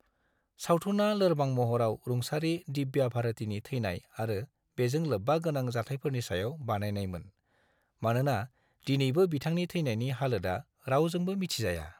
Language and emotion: Bodo, neutral